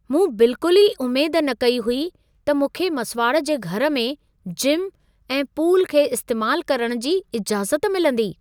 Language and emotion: Sindhi, surprised